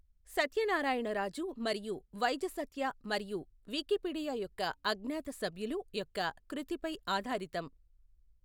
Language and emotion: Telugu, neutral